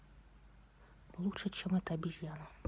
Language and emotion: Russian, neutral